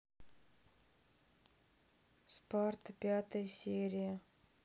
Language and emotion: Russian, sad